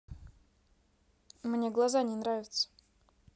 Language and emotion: Russian, neutral